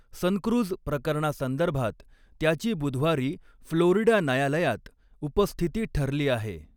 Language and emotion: Marathi, neutral